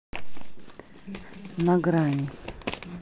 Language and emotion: Russian, neutral